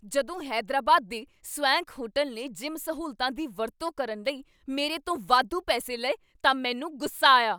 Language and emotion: Punjabi, angry